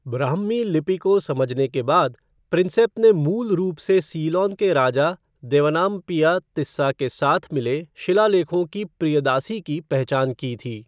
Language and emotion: Hindi, neutral